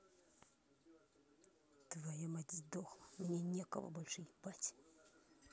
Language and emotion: Russian, angry